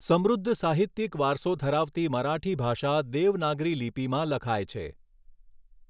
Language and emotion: Gujarati, neutral